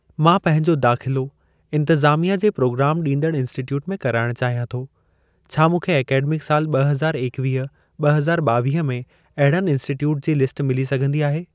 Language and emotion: Sindhi, neutral